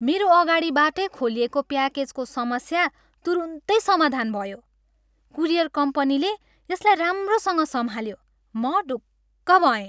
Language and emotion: Nepali, happy